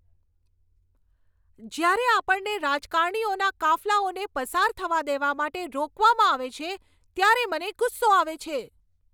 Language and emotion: Gujarati, angry